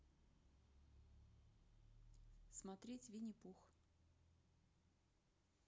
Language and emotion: Russian, neutral